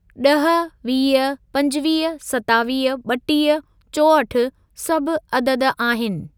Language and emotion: Sindhi, neutral